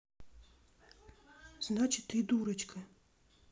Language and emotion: Russian, neutral